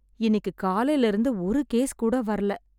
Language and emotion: Tamil, sad